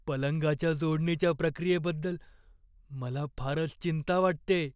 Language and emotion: Marathi, fearful